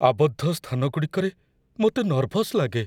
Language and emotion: Odia, fearful